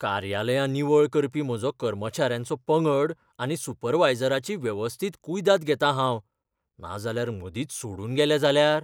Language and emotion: Goan Konkani, fearful